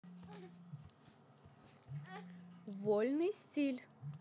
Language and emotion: Russian, positive